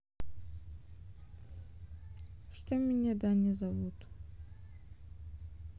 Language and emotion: Russian, sad